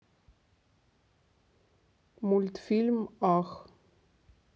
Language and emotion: Russian, neutral